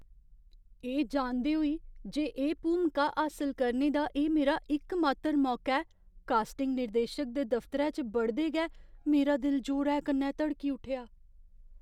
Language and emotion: Dogri, fearful